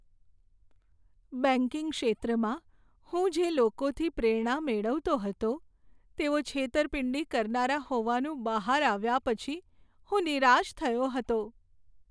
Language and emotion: Gujarati, sad